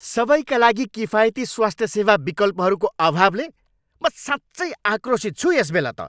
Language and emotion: Nepali, angry